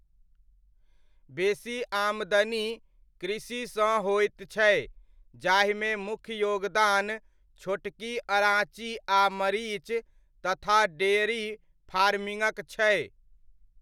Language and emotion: Maithili, neutral